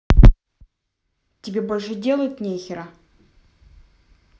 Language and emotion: Russian, angry